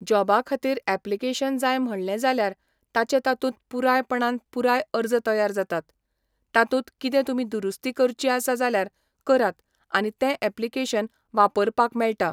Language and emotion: Goan Konkani, neutral